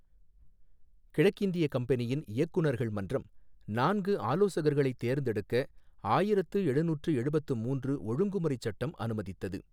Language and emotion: Tamil, neutral